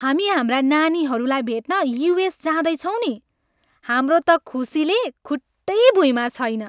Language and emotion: Nepali, happy